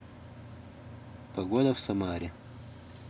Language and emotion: Russian, neutral